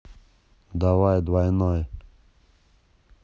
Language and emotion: Russian, angry